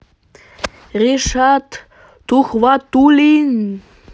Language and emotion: Russian, positive